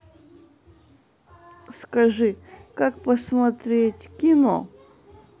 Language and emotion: Russian, neutral